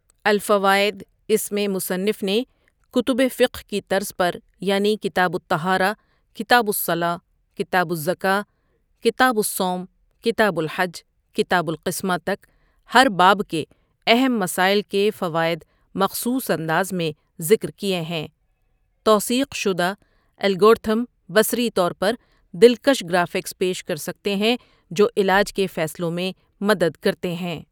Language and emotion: Urdu, neutral